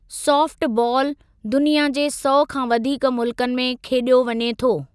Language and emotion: Sindhi, neutral